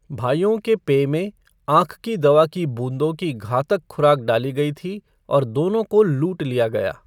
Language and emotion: Hindi, neutral